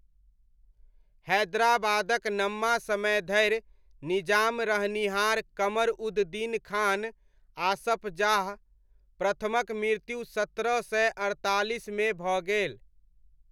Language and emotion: Maithili, neutral